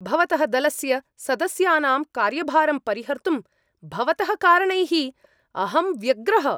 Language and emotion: Sanskrit, angry